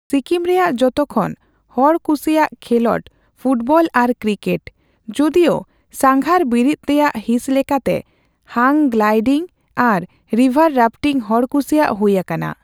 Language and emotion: Santali, neutral